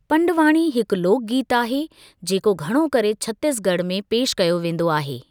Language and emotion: Sindhi, neutral